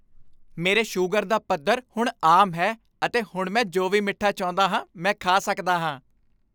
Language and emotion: Punjabi, happy